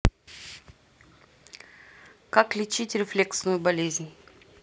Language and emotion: Russian, neutral